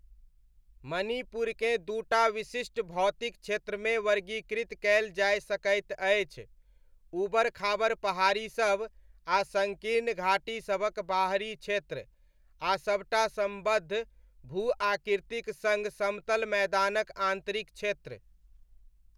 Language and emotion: Maithili, neutral